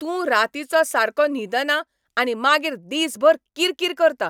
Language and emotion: Goan Konkani, angry